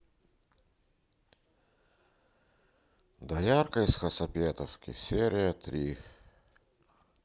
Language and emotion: Russian, sad